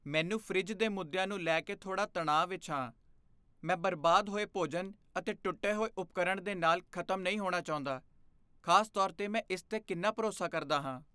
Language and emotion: Punjabi, fearful